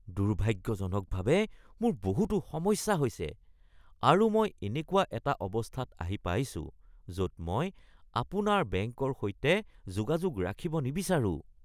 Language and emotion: Assamese, disgusted